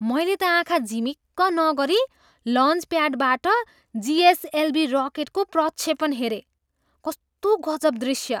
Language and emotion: Nepali, surprised